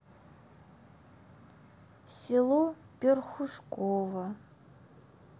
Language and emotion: Russian, sad